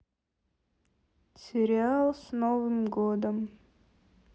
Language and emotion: Russian, sad